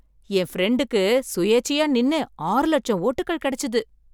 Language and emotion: Tamil, surprised